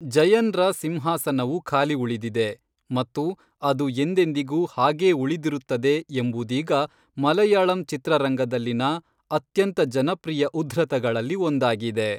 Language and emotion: Kannada, neutral